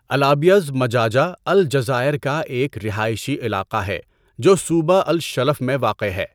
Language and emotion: Urdu, neutral